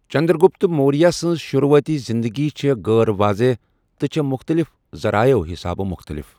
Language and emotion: Kashmiri, neutral